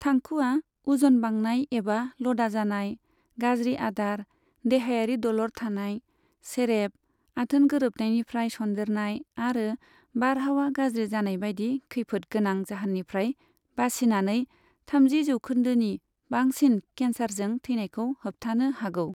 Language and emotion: Bodo, neutral